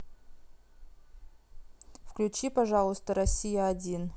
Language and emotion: Russian, neutral